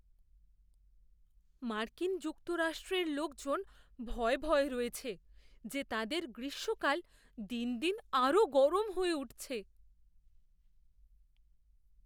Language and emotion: Bengali, fearful